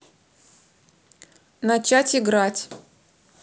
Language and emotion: Russian, neutral